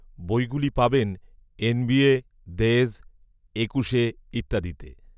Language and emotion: Bengali, neutral